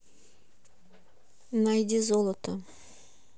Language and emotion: Russian, neutral